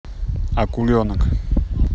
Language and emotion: Russian, neutral